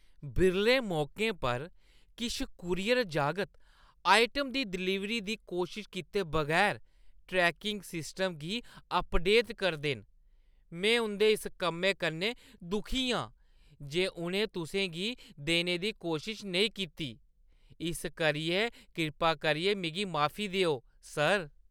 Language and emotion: Dogri, disgusted